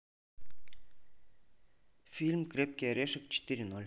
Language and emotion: Russian, neutral